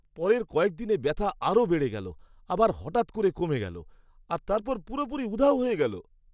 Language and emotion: Bengali, surprised